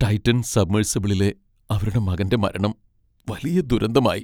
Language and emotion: Malayalam, sad